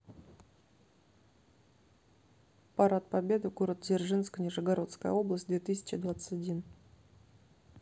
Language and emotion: Russian, neutral